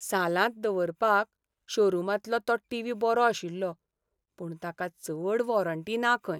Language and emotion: Goan Konkani, sad